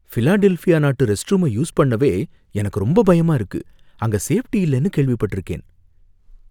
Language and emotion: Tamil, fearful